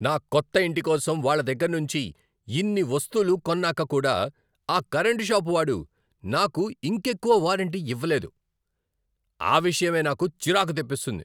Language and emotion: Telugu, angry